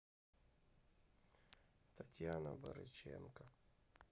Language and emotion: Russian, sad